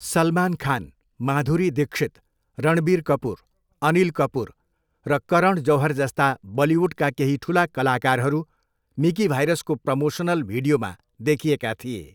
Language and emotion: Nepali, neutral